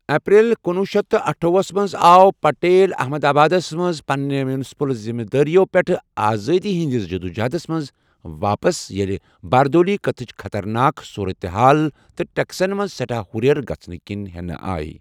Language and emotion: Kashmiri, neutral